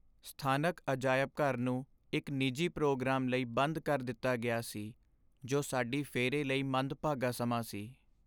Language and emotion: Punjabi, sad